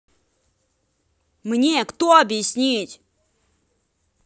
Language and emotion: Russian, angry